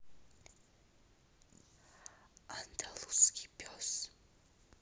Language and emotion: Russian, neutral